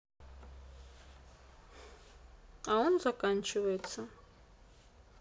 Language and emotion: Russian, neutral